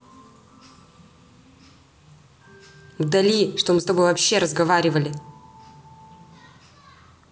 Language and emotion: Russian, angry